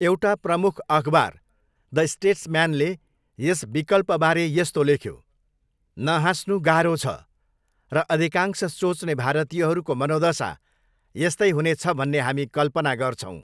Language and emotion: Nepali, neutral